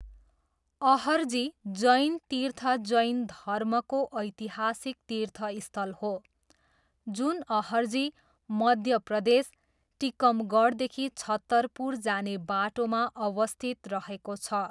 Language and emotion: Nepali, neutral